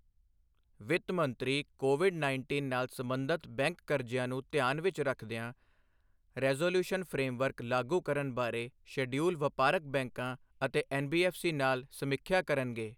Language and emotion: Punjabi, neutral